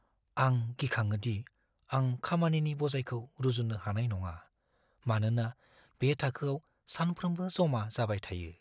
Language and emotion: Bodo, fearful